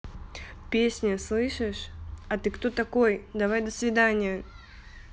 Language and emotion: Russian, angry